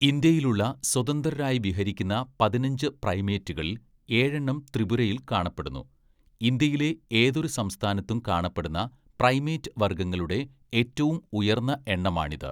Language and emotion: Malayalam, neutral